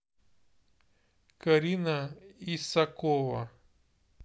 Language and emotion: Russian, neutral